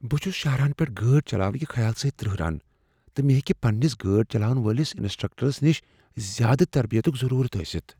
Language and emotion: Kashmiri, fearful